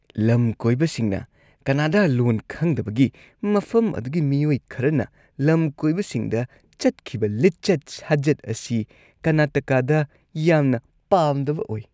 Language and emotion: Manipuri, disgusted